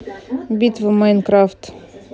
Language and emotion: Russian, neutral